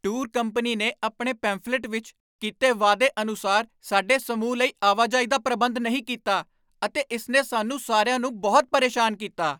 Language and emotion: Punjabi, angry